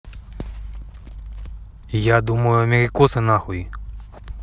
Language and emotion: Russian, angry